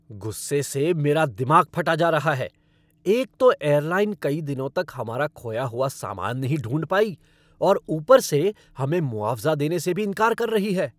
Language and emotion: Hindi, angry